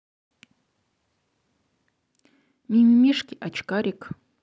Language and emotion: Russian, neutral